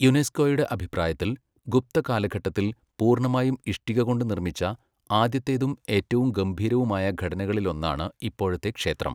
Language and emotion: Malayalam, neutral